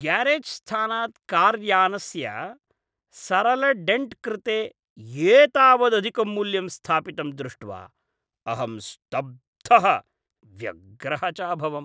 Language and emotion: Sanskrit, disgusted